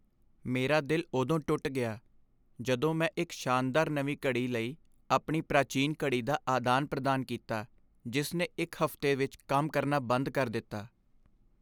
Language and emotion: Punjabi, sad